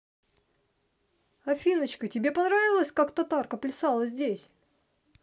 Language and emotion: Russian, positive